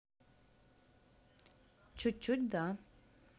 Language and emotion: Russian, neutral